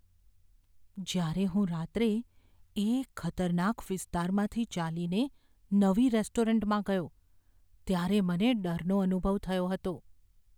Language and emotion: Gujarati, fearful